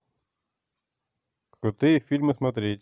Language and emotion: Russian, neutral